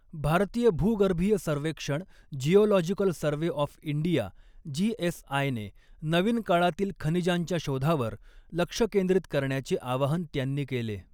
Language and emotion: Marathi, neutral